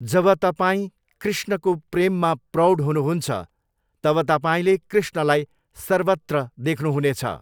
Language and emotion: Nepali, neutral